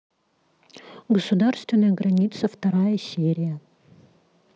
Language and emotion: Russian, neutral